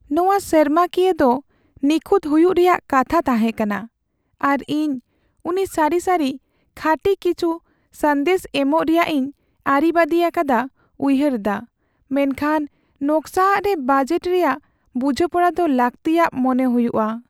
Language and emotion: Santali, sad